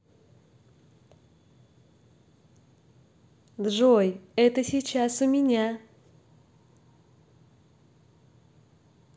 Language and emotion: Russian, positive